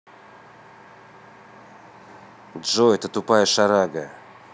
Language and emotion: Russian, angry